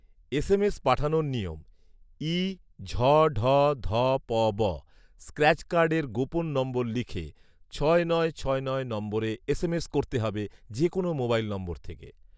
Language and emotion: Bengali, neutral